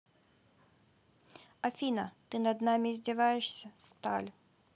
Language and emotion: Russian, neutral